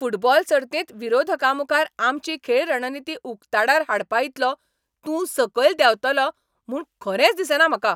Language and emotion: Goan Konkani, angry